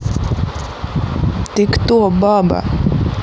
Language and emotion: Russian, neutral